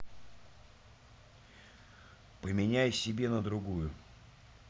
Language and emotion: Russian, neutral